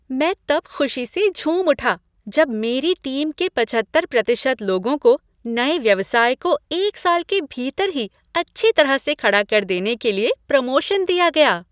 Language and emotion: Hindi, happy